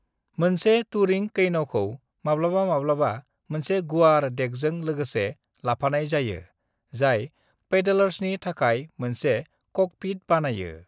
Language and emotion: Bodo, neutral